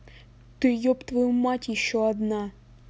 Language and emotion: Russian, angry